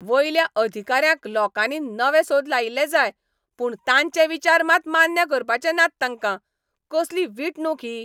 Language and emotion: Goan Konkani, angry